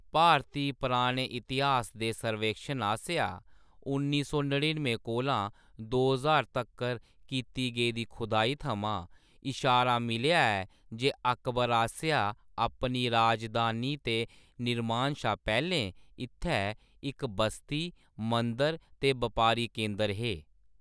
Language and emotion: Dogri, neutral